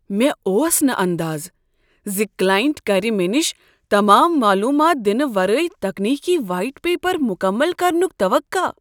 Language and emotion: Kashmiri, surprised